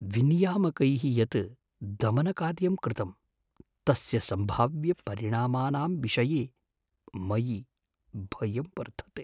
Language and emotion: Sanskrit, fearful